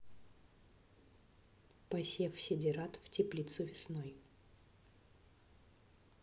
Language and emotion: Russian, neutral